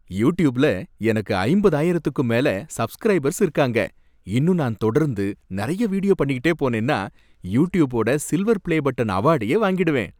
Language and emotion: Tamil, happy